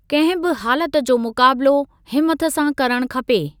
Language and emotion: Sindhi, neutral